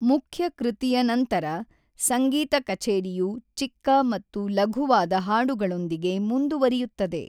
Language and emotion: Kannada, neutral